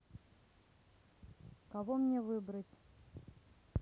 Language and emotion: Russian, neutral